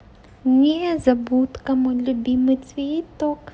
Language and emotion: Russian, positive